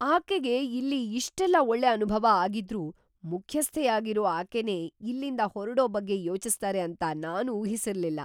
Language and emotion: Kannada, surprised